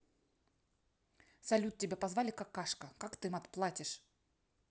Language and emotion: Russian, angry